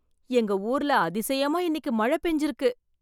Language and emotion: Tamil, surprised